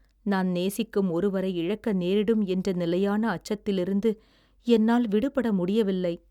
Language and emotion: Tamil, sad